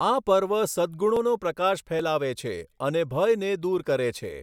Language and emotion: Gujarati, neutral